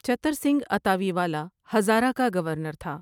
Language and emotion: Urdu, neutral